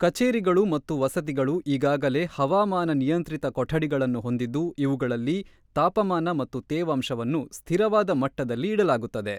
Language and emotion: Kannada, neutral